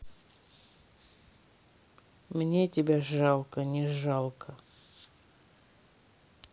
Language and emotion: Russian, neutral